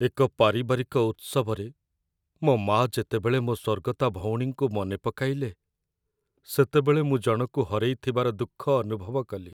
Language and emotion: Odia, sad